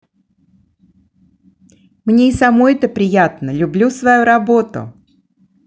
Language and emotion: Russian, positive